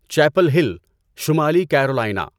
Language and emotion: Urdu, neutral